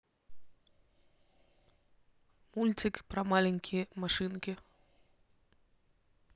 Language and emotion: Russian, neutral